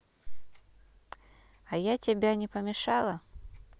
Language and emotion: Russian, neutral